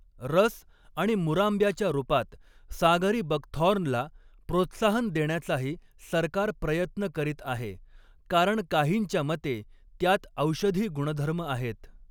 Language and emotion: Marathi, neutral